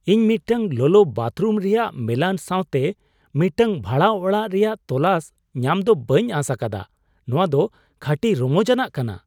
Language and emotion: Santali, surprised